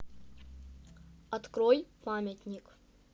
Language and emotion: Russian, neutral